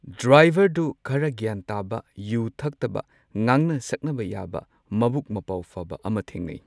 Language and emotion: Manipuri, neutral